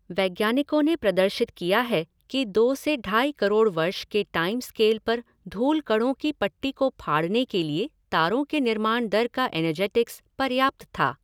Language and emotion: Hindi, neutral